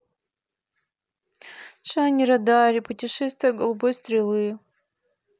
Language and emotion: Russian, sad